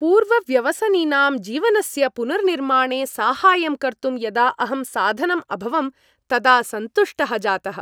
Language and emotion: Sanskrit, happy